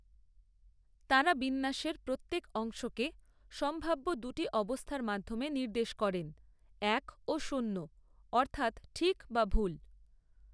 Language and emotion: Bengali, neutral